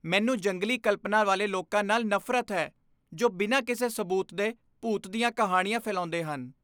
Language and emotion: Punjabi, disgusted